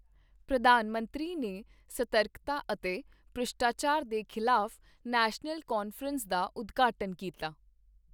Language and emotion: Punjabi, neutral